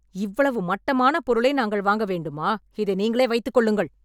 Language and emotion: Tamil, angry